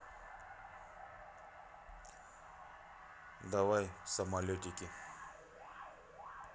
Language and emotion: Russian, neutral